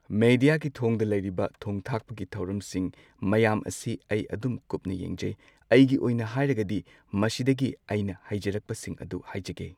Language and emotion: Manipuri, neutral